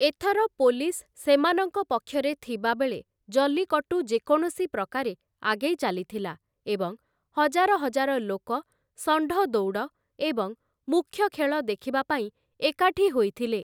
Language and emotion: Odia, neutral